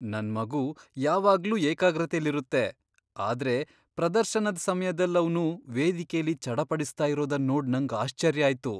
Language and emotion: Kannada, surprised